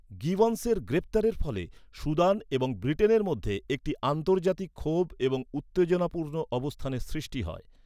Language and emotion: Bengali, neutral